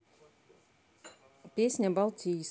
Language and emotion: Russian, neutral